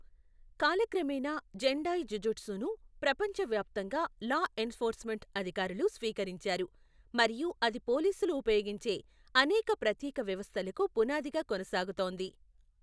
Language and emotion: Telugu, neutral